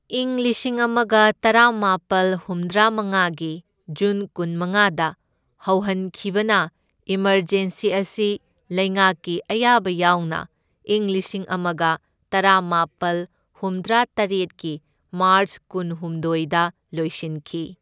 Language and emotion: Manipuri, neutral